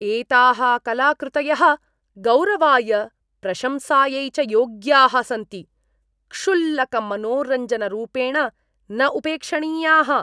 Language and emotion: Sanskrit, disgusted